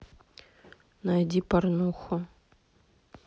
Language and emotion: Russian, neutral